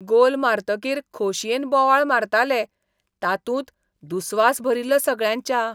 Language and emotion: Goan Konkani, disgusted